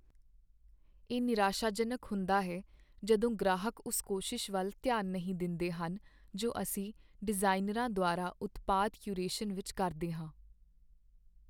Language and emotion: Punjabi, sad